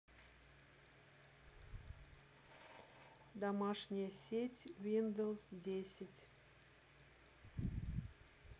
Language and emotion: Russian, neutral